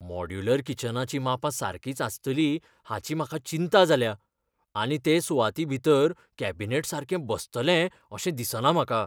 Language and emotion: Goan Konkani, fearful